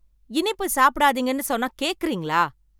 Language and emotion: Tamil, angry